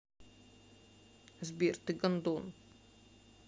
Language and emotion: Russian, sad